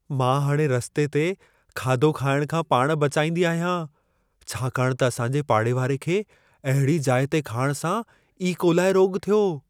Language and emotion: Sindhi, fearful